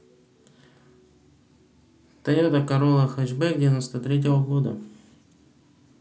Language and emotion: Russian, neutral